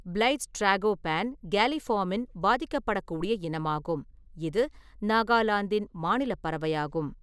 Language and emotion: Tamil, neutral